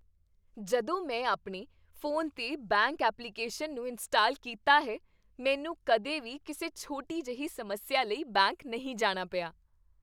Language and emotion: Punjabi, happy